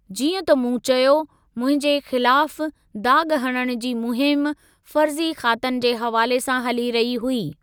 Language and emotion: Sindhi, neutral